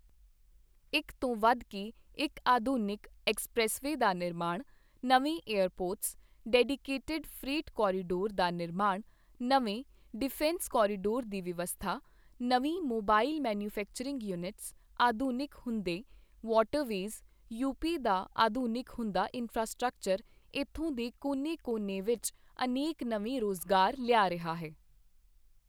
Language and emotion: Punjabi, neutral